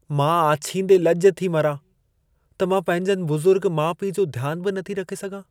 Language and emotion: Sindhi, sad